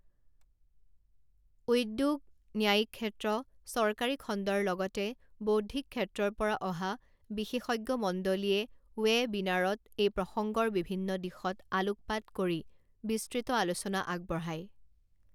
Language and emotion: Assamese, neutral